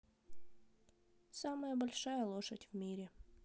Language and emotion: Russian, neutral